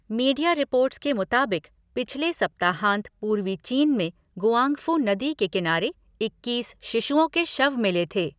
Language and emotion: Hindi, neutral